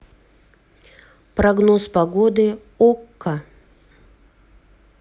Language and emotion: Russian, neutral